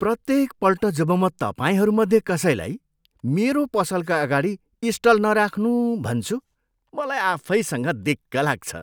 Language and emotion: Nepali, disgusted